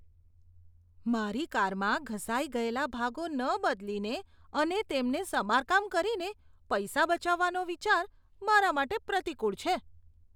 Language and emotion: Gujarati, disgusted